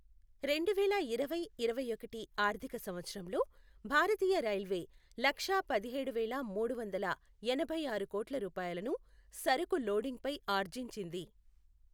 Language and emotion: Telugu, neutral